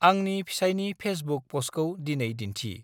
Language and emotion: Bodo, neutral